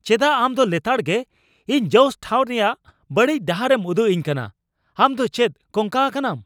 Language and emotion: Santali, angry